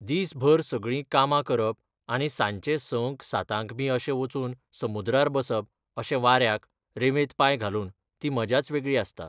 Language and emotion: Goan Konkani, neutral